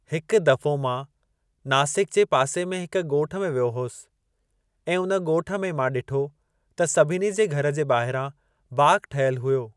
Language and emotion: Sindhi, neutral